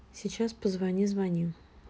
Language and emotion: Russian, neutral